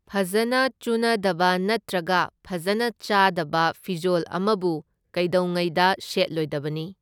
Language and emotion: Manipuri, neutral